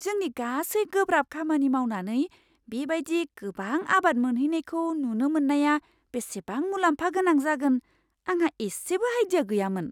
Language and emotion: Bodo, surprised